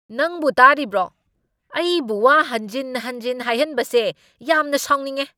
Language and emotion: Manipuri, angry